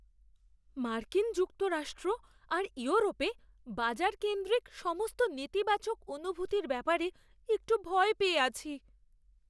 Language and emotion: Bengali, fearful